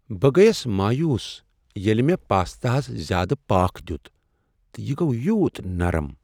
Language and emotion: Kashmiri, sad